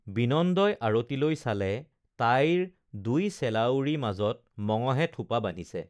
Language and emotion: Assamese, neutral